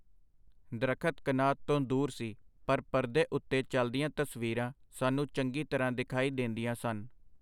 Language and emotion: Punjabi, neutral